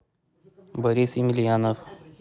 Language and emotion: Russian, neutral